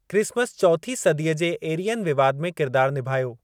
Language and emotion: Sindhi, neutral